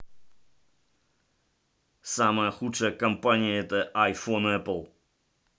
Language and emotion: Russian, angry